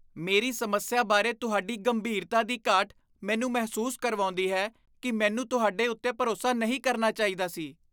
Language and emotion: Punjabi, disgusted